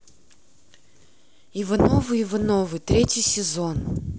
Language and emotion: Russian, neutral